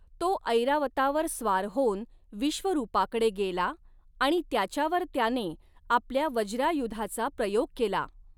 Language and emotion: Marathi, neutral